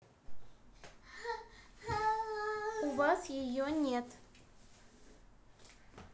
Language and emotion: Russian, neutral